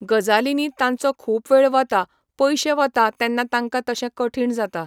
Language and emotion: Goan Konkani, neutral